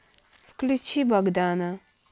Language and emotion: Russian, neutral